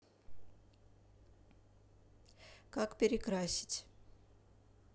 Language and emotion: Russian, neutral